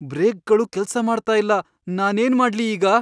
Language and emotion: Kannada, fearful